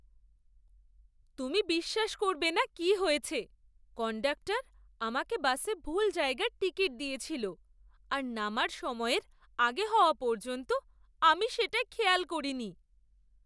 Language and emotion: Bengali, surprised